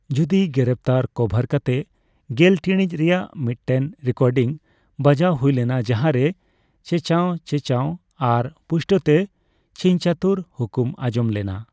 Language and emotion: Santali, neutral